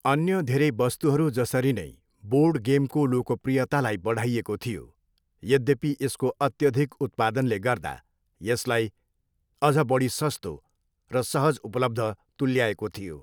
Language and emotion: Nepali, neutral